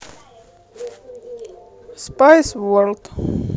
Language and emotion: Russian, neutral